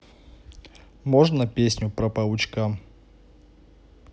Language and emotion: Russian, neutral